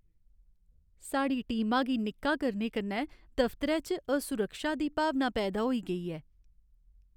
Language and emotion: Dogri, sad